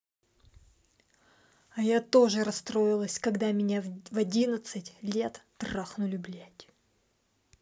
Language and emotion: Russian, angry